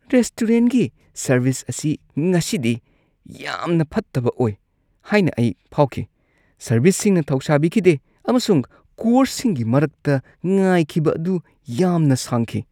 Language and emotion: Manipuri, disgusted